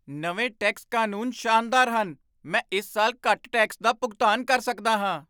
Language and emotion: Punjabi, surprised